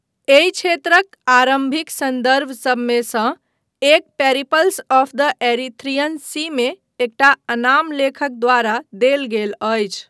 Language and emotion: Maithili, neutral